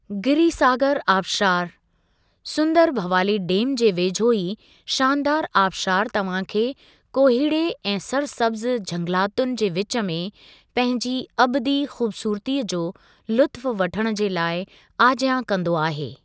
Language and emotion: Sindhi, neutral